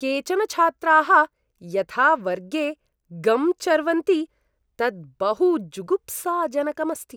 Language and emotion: Sanskrit, disgusted